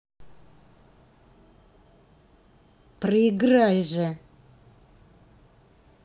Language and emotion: Russian, angry